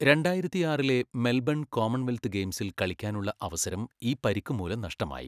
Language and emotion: Malayalam, neutral